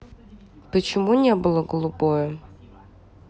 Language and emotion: Russian, neutral